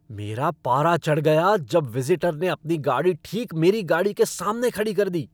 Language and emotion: Hindi, angry